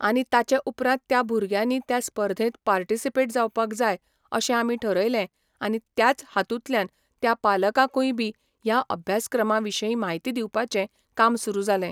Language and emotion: Goan Konkani, neutral